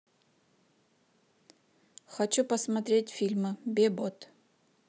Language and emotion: Russian, neutral